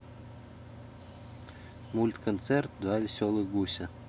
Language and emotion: Russian, neutral